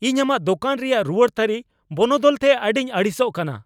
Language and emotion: Santali, angry